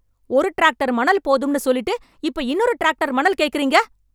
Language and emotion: Tamil, angry